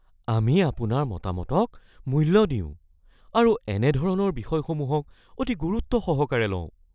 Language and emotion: Assamese, fearful